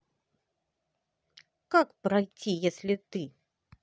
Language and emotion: Russian, angry